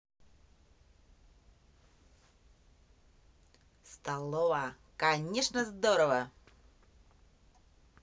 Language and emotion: Russian, positive